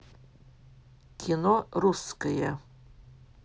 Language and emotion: Russian, neutral